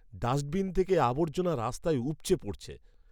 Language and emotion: Bengali, disgusted